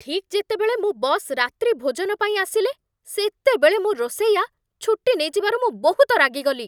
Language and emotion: Odia, angry